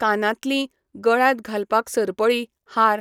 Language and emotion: Goan Konkani, neutral